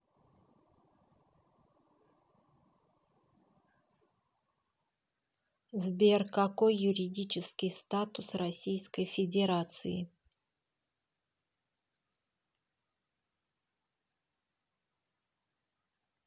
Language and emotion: Russian, neutral